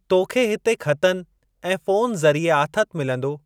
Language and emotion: Sindhi, neutral